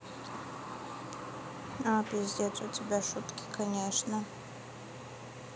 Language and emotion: Russian, neutral